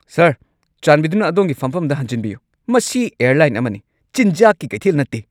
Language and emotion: Manipuri, angry